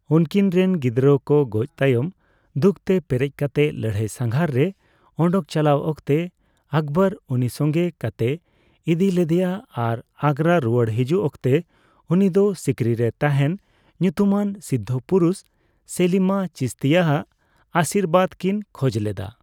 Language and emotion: Santali, neutral